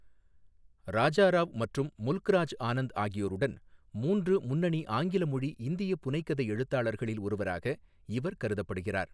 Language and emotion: Tamil, neutral